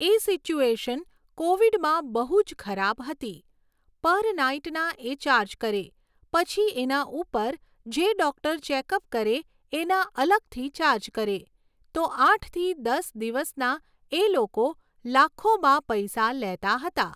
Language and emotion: Gujarati, neutral